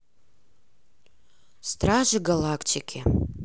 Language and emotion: Russian, neutral